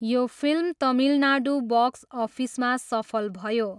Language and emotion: Nepali, neutral